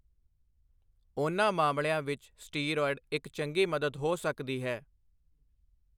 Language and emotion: Punjabi, neutral